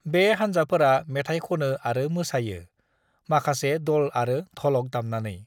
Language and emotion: Bodo, neutral